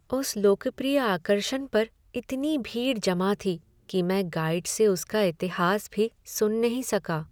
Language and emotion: Hindi, sad